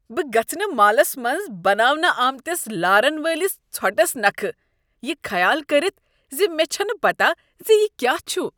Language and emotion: Kashmiri, disgusted